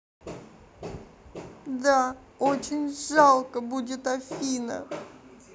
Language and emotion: Russian, sad